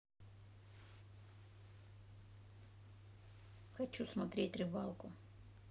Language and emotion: Russian, neutral